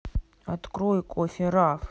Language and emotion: Russian, sad